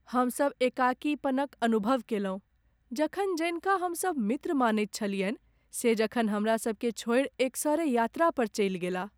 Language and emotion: Maithili, sad